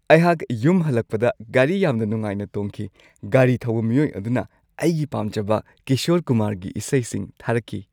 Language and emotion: Manipuri, happy